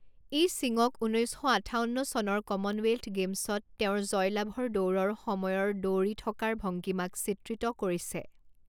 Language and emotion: Assamese, neutral